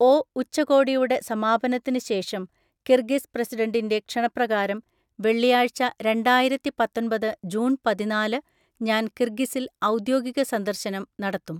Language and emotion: Malayalam, neutral